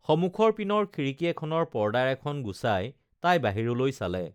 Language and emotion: Assamese, neutral